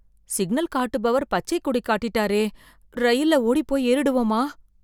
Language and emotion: Tamil, fearful